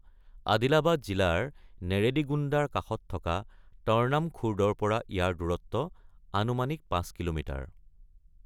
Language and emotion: Assamese, neutral